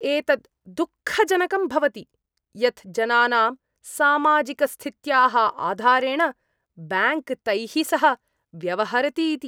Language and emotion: Sanskrit, disgusted